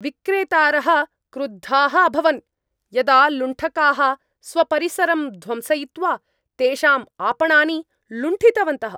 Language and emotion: Sanskrit, angry